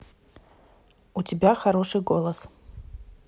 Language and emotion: Russian, neutral